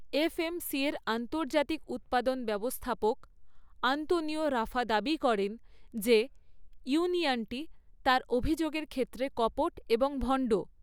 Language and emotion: Bengali, neutral